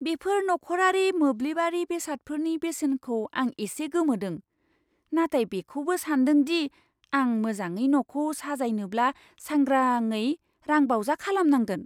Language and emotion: Bodo, surprised